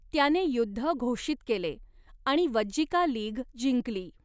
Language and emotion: Marathi, neutral